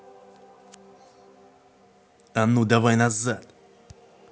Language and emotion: Russian, angry